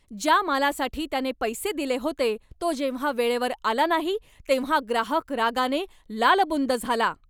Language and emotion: Marathi, angry